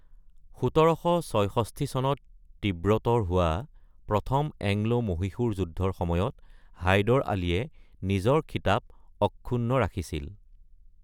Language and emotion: Assamese, neutral